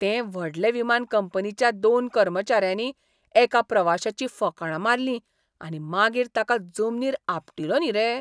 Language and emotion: Goan Konkani, disgusted